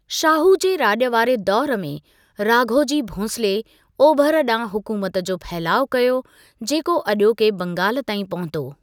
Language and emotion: Sindhi, neutral